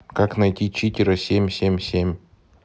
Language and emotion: Russian, neutral